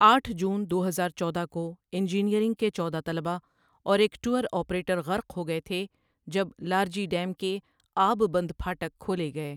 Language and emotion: Urdu, neutral